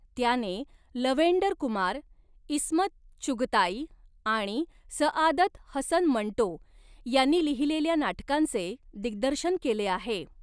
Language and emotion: Marathi, neutral